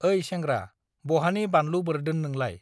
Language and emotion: Bodo, neutral